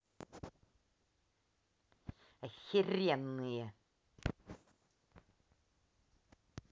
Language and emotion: Russian, angry